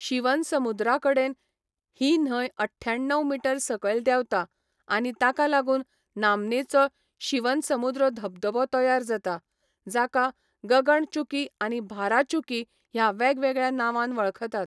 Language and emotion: Goan Konkani, neutral